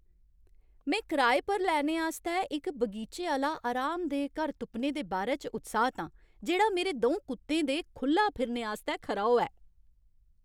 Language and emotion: Dogri, happy